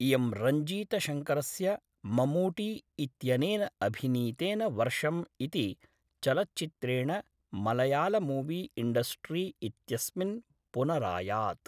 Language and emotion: Sanskrit, neutral